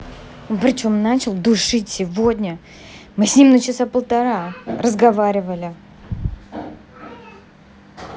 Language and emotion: Russian, angry